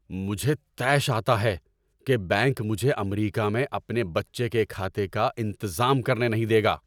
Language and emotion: Urdu, angry